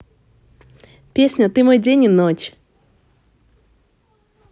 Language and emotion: Russian, positive